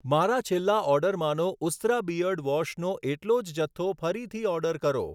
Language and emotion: Gujarati, neutral